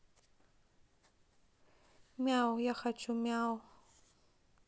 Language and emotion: Russian, neutral